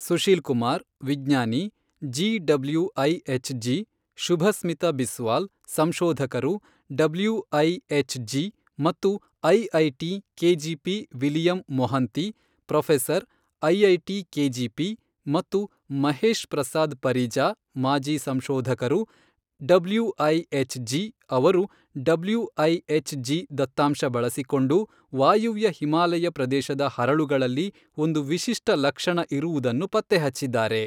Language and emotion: Kannada, neutral